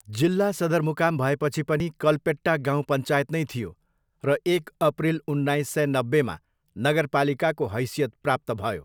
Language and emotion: Nepali, neutral